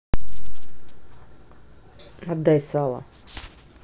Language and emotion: Russian, angry